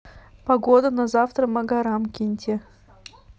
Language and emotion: Russian, neutral